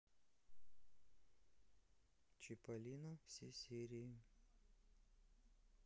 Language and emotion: Russian, neutral